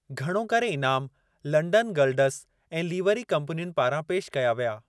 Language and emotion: Sindhi, neutral